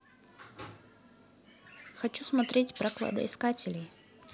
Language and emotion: Russian, neutral